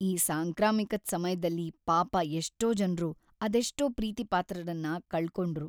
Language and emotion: Kannada, sad